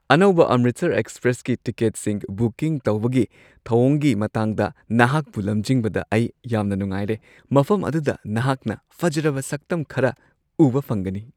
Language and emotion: Manipuri, happy